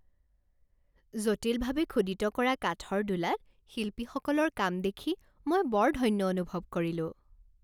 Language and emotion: Assamese, happy